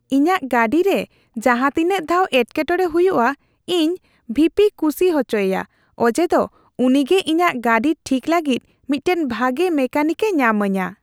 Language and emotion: Santali, happy